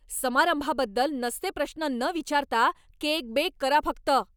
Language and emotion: Marathi, angry